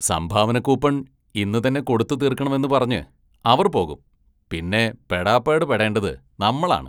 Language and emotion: Malayalam, disgusted